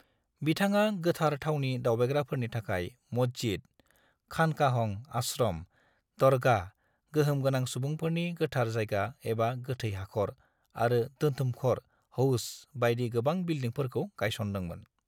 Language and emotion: Bodo, neutral